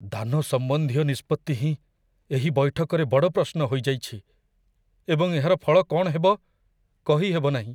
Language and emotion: Odia, fearful